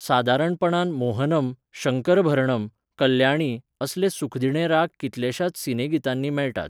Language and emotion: Goan Konkani, neutral